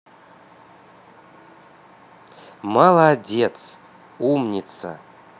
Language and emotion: Russian, positive